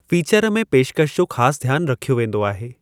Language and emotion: Sindhi, neutral